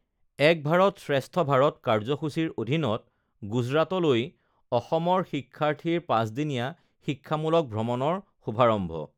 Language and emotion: Assamese, neutral